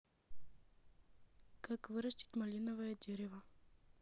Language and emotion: Russian, neutral